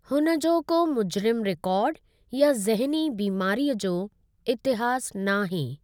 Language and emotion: Sindhi, neutral